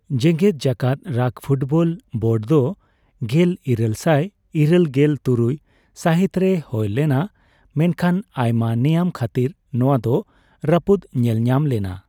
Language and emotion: Santali, neutral